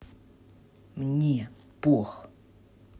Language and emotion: Russian, angry